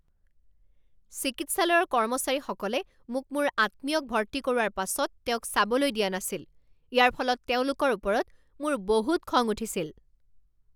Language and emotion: Assamese, angry